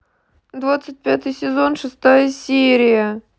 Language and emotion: Russian, sad